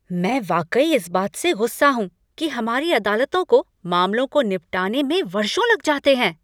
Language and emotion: Hindi, angry